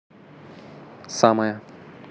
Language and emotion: Russian, neutral